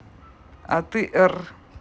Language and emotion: Russian, neutral